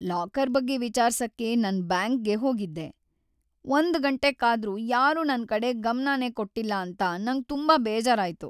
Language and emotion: Kannada, sad